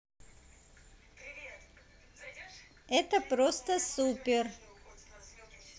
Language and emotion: Russian, positive